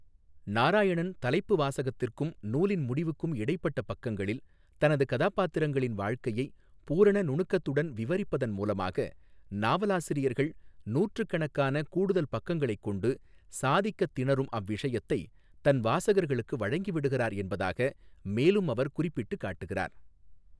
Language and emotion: Tamil, neutral